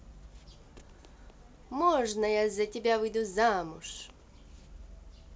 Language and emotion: Russian, positive